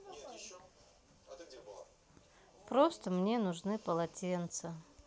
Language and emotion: Russian, sad